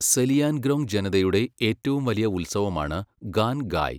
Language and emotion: Malayalam, neutral